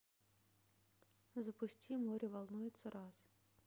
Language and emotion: Russian, neutral